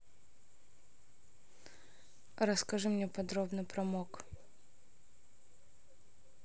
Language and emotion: Russian, neutral